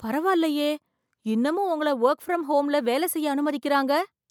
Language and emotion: Tamil, surprised